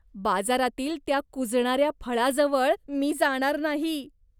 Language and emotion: Marathi, disgusted